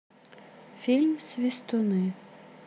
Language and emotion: Russian, neutral